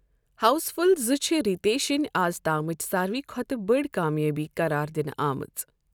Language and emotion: Kashmiri, neutral